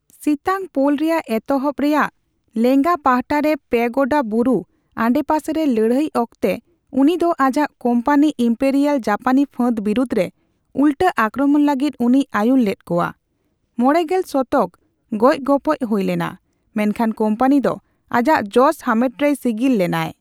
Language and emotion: Santali, neutral